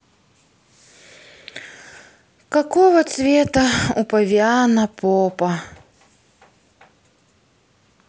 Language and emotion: Russian, sad